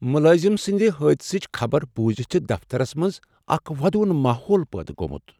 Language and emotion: Kashmiri, sad